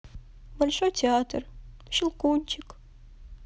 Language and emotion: Russian, sad